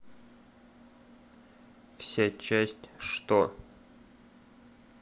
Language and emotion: Russian, neutral